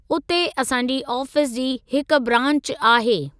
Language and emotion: Sindhi, neutral